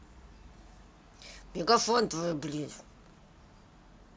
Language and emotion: Russian, angry